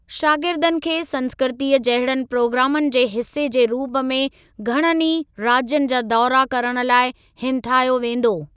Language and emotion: Sindhi, neutral